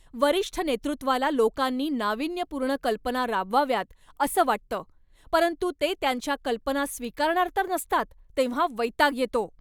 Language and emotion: Marathi, angry